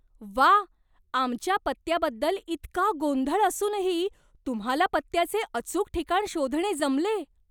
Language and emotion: Marathi, surprised